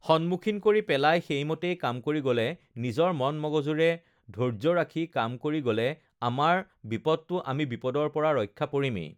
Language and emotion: Assamese, neutral